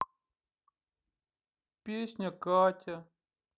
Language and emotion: Russian, sad